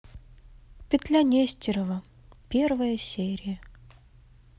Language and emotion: Russian, sad